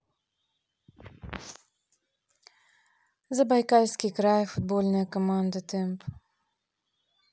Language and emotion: Russian, neutral